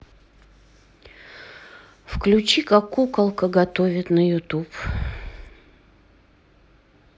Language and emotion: Russian, sad